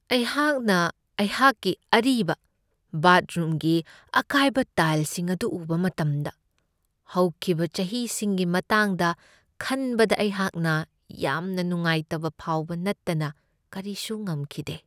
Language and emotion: Manipuri, sad